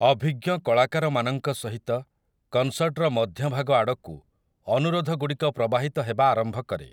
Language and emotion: Odia, neutral